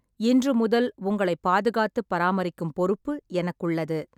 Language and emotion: Tamil, neutral